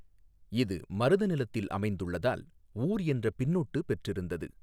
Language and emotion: Tamil, neutral